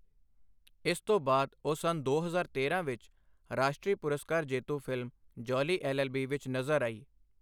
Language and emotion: Punjabi, neutral